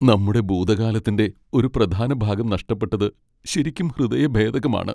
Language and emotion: Malayalam, sad